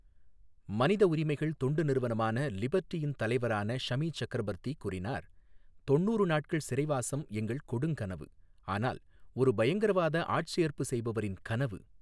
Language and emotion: Tamil, neutral